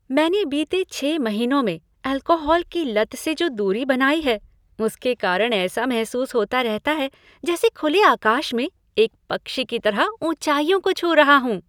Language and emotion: Hindi, happy